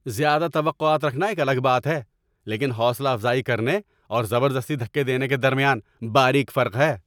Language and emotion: Urdu, angry